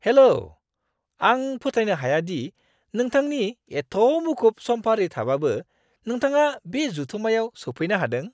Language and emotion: Bodo, surprised